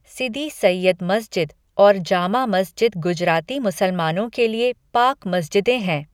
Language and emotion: Hindi, neutral